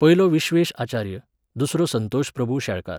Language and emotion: Goan Konkani, neutral